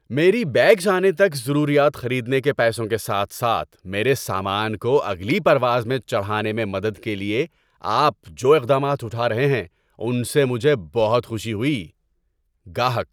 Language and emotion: Urdu, happy